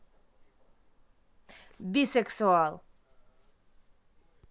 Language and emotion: Russian, neutral